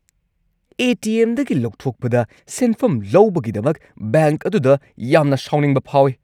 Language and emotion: Manipuri, angry